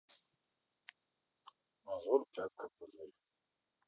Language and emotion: Russian, neutral